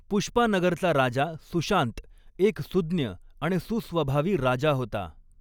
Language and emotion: Marathi, neutral